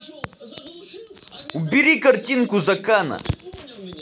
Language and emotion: Russian, angry